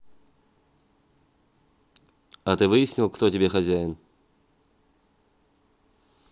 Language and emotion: Russian, neutral